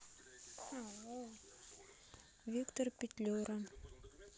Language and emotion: Russian, neutral